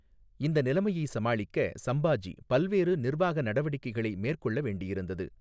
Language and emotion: Tamil, neutral